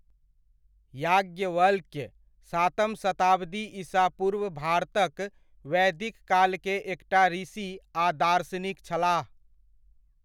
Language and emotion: Maithili, neutral